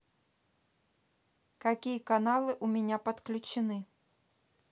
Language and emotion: Russian, neutral